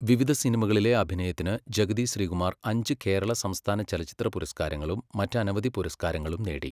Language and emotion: Malayalam, neutral